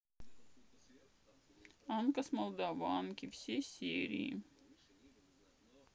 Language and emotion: Russian, sad